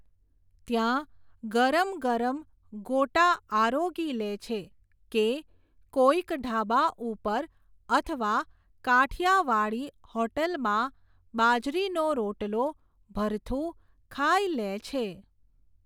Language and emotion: Gujarati, neutral